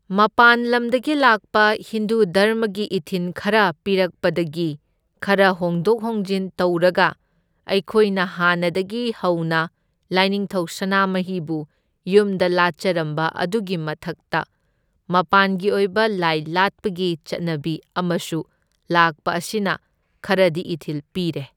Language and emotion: Manipuri, neutral